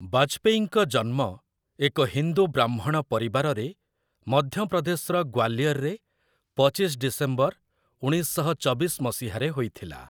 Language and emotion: Odia, neutral